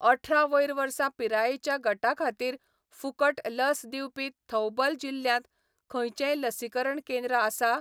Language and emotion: Goan Konkani, neutral